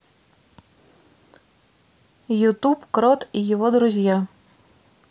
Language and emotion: Russian, neutral